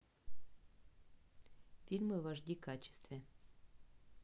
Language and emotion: Russian, neutral